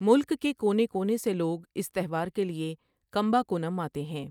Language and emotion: Urdu, neutral